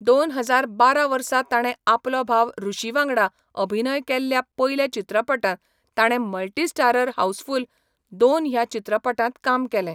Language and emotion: Goan Konkani, neutral